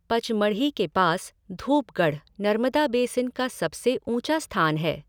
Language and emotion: Hindi, neutral